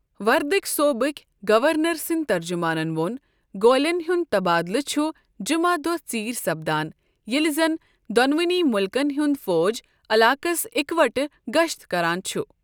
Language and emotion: Kashmiri, neutral